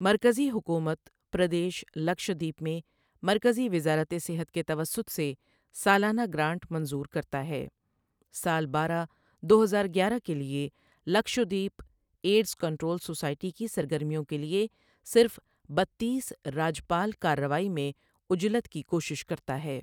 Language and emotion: Urdu, neutral